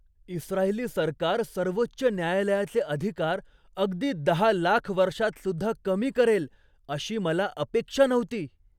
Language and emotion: Marathi, surprised